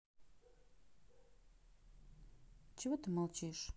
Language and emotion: Russian, neutral